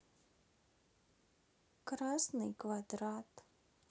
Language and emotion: Russian, sad